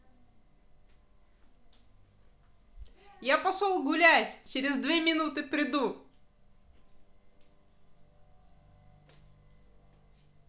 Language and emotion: Russian, positive